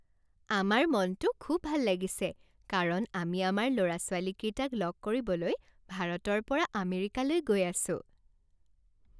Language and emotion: Assamese, happy